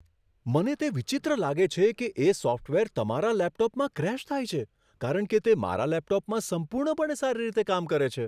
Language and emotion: Gujarati, surprised